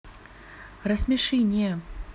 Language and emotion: Russian, neutral